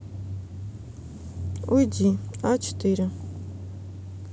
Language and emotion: Russian, neutral